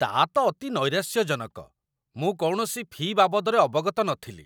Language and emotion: Odia, disgusted